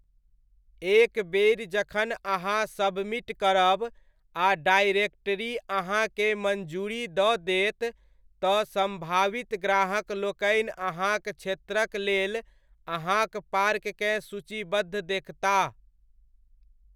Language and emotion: Maithili, neutral